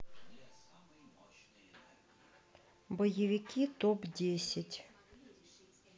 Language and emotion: Russian, neutral